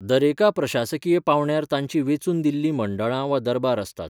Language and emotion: Goan Konkani, neutral